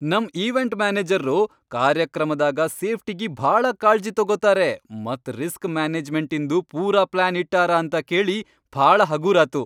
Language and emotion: Kannada, happy